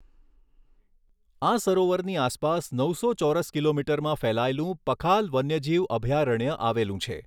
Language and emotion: Gujarati, neutral